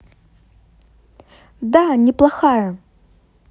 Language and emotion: Russian, positive